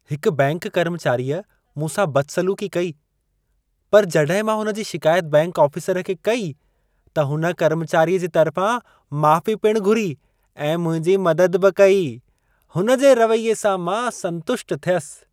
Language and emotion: Sindhi, happy